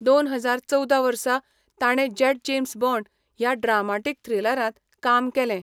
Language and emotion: Goan Konkani, neutral